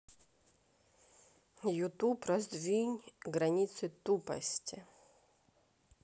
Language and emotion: Russian, neutral